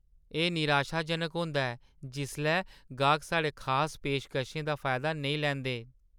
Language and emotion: Dogri, sad